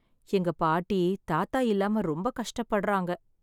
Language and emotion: Tamil, sad